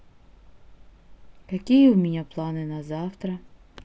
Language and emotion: Russian, neutral